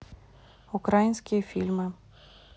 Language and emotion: Russian, neutral